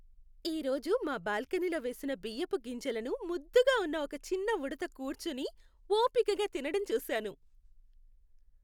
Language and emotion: Telugu, happy